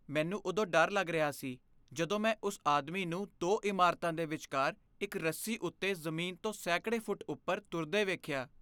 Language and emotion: Punjabi, fearful